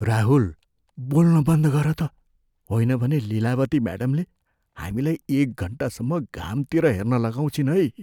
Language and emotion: Nepali, fearful